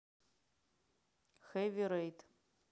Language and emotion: Russian, neutral